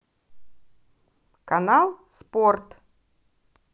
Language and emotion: Russian, positive